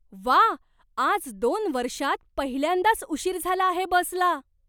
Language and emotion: Marathi, surprised